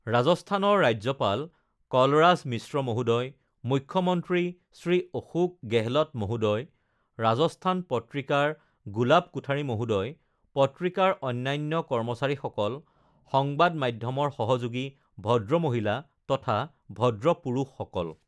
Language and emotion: Assamese, neutral